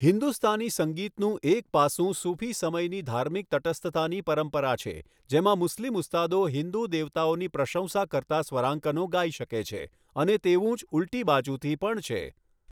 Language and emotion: Gujarati, neutral